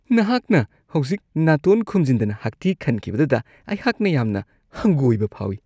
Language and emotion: Manipuri, disgusted